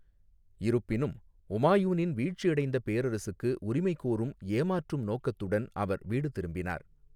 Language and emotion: Tamil, neutral